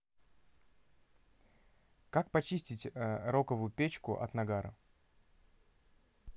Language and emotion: Russian, neutral